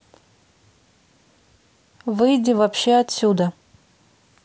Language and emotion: Russian, angry